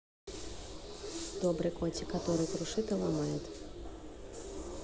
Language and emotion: Russian, neutral